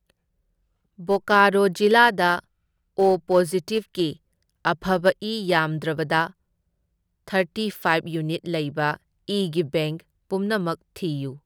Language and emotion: Manipuri, neutral